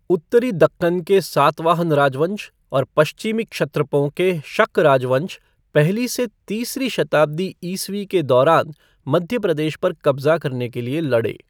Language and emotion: Hindi, neutral